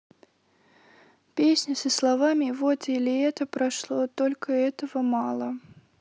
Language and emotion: Russian, sad